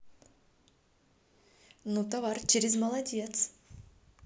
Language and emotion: Russian, positive